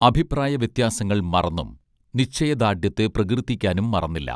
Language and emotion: Malayalam, neutral